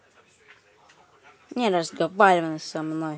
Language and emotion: Russian, angry